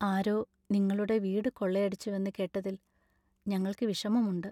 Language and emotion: Malayalam, sad